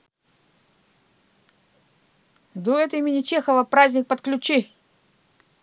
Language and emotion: Russian, neutral